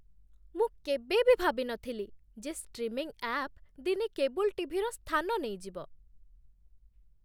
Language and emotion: Odia, surprised